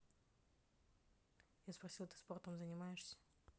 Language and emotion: Russian, neutral